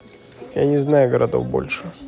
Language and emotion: Russian, neutral